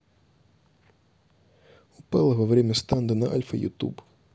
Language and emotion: Russian, neutral